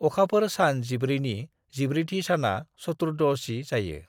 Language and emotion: Bodo, neutral